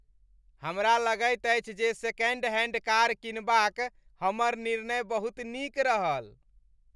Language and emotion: Maithili, happy